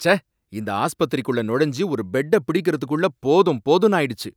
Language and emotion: Tamil, angry